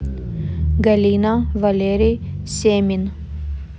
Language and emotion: Russian, neutral